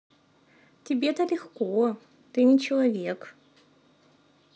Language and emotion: Russian, neutral